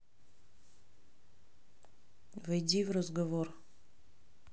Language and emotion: Russian, neutral